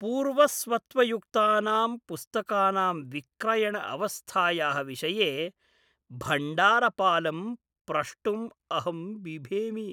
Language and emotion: Sanskrit, fearful